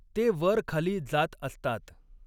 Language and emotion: Marathi, neutral